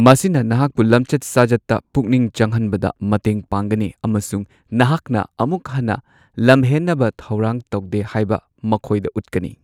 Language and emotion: Manipuri, neutral